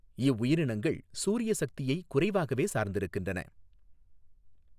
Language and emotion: Tamil, neutral